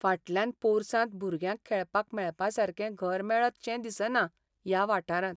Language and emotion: Goan Konkani, sad